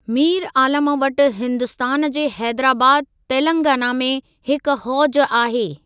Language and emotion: Sindhi, neutral